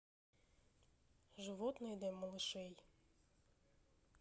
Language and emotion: Russian, neutral